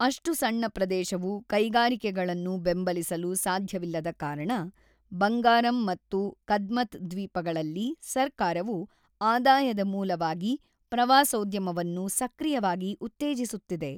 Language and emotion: Kannada, neutral